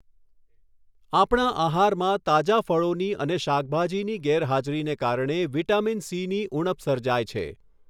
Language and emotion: Gujarati, neutral